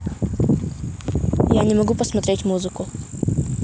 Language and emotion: Russian, neutral